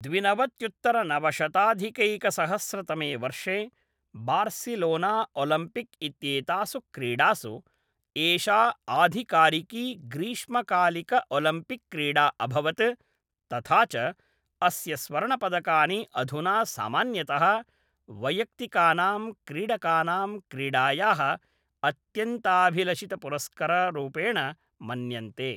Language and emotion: Sanskrit, neutral